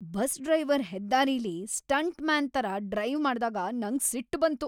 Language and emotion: Kannada, angry